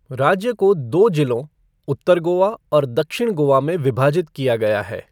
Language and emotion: Hindi, neutral